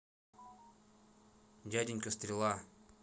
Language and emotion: Russian, neutral